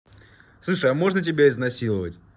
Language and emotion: Russian, neutral